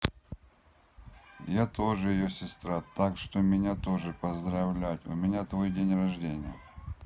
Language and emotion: Russian, neutral